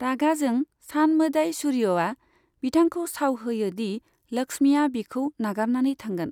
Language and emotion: Bodo, neutral